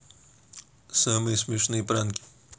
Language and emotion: Russian, neutral